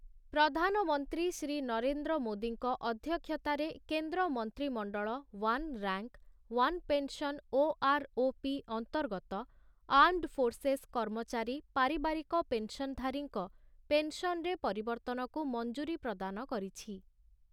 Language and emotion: Odia, neutral